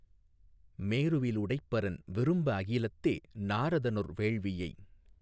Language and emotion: Tamil, neutral